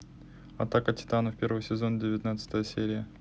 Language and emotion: Russian, neutral